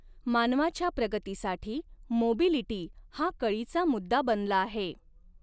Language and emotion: Marathi, neutral